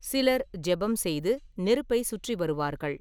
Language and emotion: Tamil, neutral